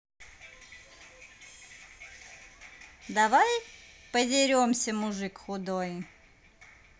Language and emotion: Russian, positive